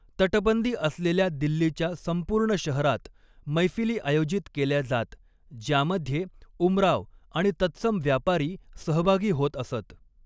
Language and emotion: Marathi, neutral